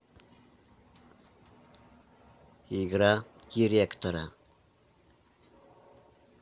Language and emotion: Russian, neutral